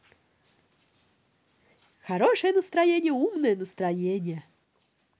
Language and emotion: Russian, positive